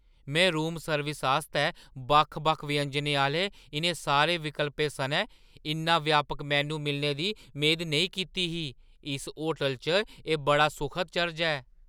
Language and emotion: Dogri, surprised